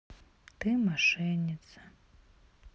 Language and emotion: Russian, sad